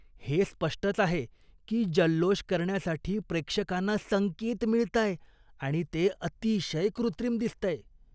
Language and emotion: Marathi, disgusted